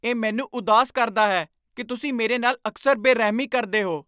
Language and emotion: Punjabi, angry